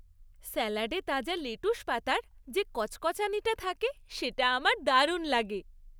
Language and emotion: Bengali, happy